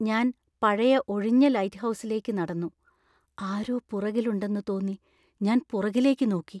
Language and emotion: Malayalam, fearful